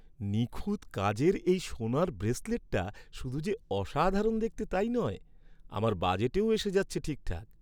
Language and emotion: Bengali, happy